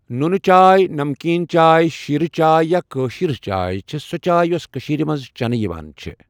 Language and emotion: Kashmiri, neutral